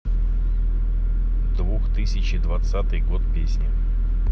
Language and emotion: Russian, neutral